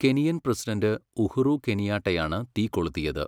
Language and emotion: Malayalam, neutral